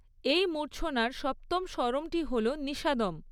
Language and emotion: Bengali, neutral